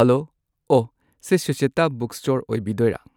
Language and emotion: Manipuri, neutral